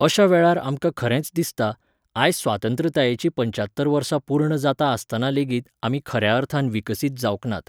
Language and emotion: Goan Konkani, neutral